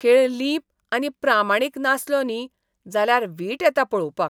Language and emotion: Goan Konkani, disgusted